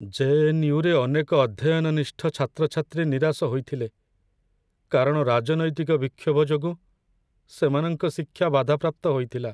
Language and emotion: Odia, sad